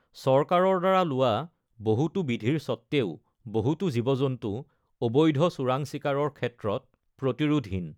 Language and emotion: Assamese, neutral